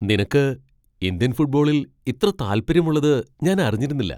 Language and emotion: Malayalam, surprised